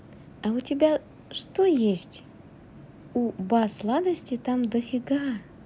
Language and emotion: Russian, positive